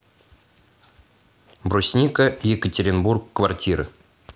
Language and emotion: Russian, neutral